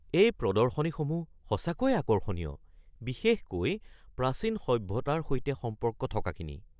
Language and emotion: Assamese, surprised